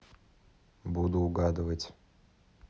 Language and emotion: Russian, neutral